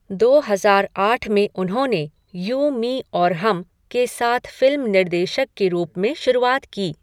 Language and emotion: Hindi, neutral